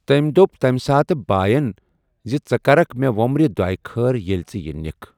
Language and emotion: Kashmiri, neutral